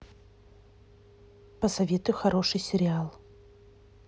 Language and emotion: Russian, neutral